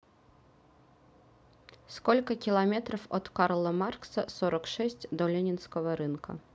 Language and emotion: Russian, neutral